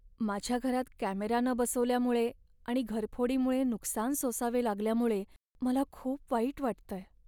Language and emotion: Marathi, sad